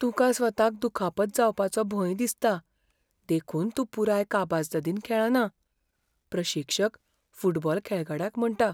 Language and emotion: Goan Konkani, fearful